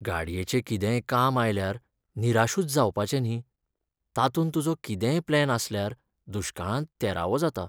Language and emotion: Goan Konkani, sad